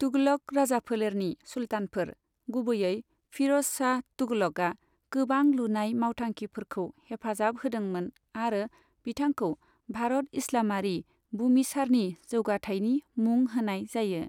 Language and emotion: Bodo, neutral